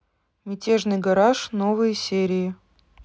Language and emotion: Russian, neutral